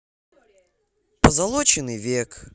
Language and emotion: Russian, positive